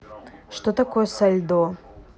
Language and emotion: Russian, neutral